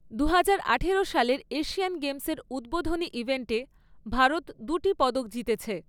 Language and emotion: Bengali, neutral